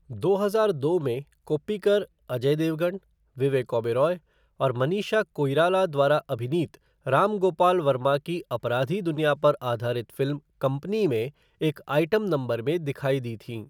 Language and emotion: Hindi, neutral